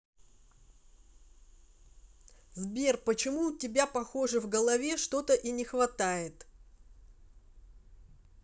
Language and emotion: Russian, angry